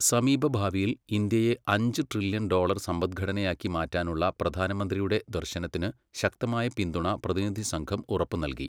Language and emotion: Malayalam, neutral